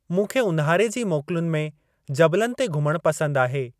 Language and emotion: Sindhi, neutral